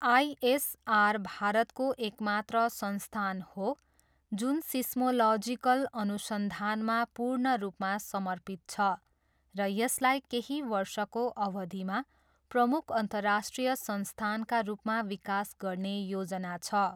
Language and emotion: Nepali, neutral